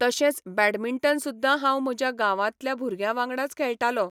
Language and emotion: Goan Konkani, neutral